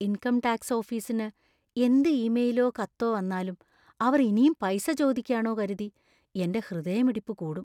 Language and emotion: Malayalam, fearful